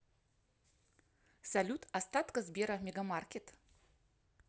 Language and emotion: Russian, positive